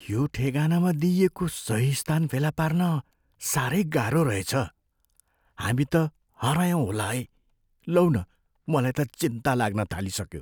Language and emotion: Nepali, fearful